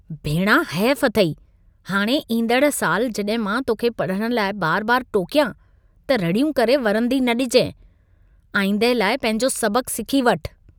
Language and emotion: Sindhi, disgusted